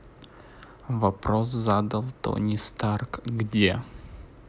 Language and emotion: Russian, neutral